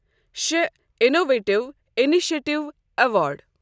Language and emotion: Kashmiri, neutral